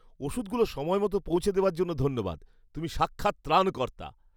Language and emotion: Bengali, happy